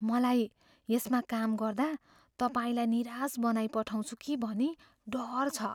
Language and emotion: Nepali, fearful